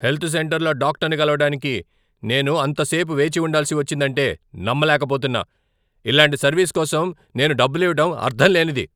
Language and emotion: Telugu, angry